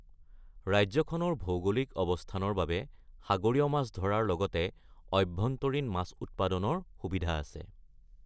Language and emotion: Assamese, neutral